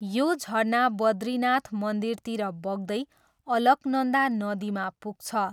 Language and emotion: Nepali, neutral